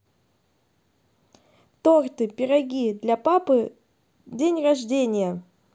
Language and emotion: Russian, positive